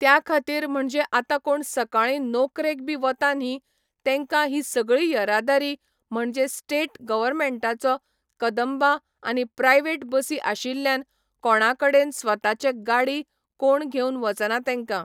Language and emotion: Goan Konkani, neutral